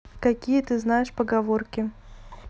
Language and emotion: Russian, neutral